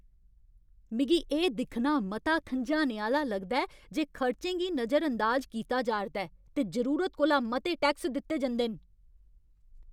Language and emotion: Dogri, angry